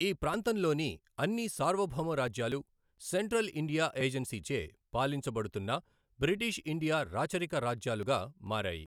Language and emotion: Telugu, neutral